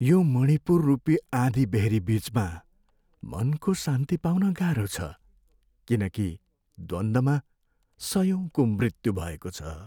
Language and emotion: Nepali, sad